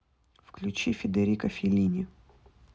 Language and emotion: Russian, neutral